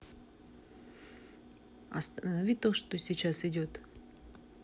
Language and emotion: Russian, neutral